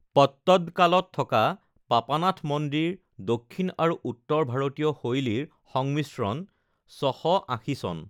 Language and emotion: Assamese, neutral